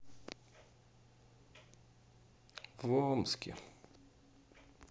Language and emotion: Russian, sad